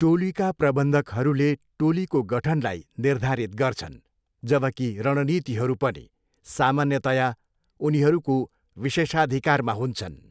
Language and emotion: Nepali, neutral